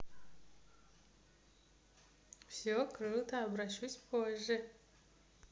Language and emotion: Russian, positive